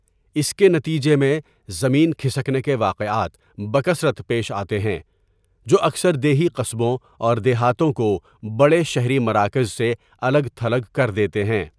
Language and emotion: Urdu, neutral